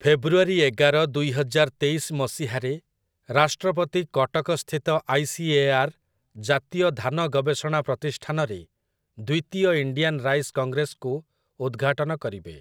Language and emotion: Odia, neutral